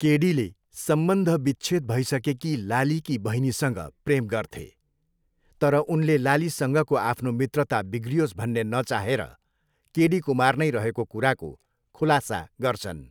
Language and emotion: Nepali, neutral